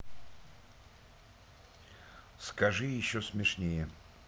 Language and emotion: Russian, neutral